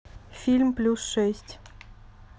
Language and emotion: Russian, neutral